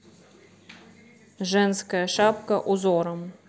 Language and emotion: Russian, neutral